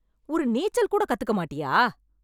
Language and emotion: Tamil, angry